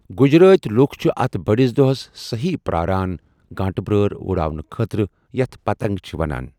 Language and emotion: Kashmiri, neutral